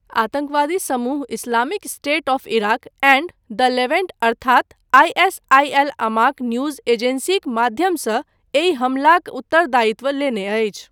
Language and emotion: Maithili, neutral